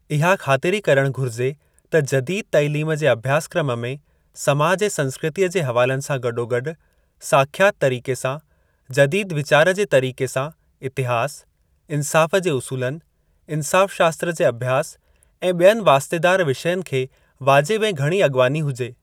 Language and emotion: Sindhi, neutral